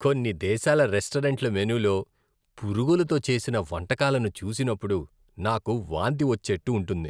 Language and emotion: Telugu, disgusted